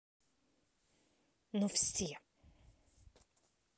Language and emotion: Russian, angry